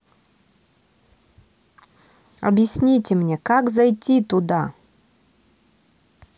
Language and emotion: Russian, neutral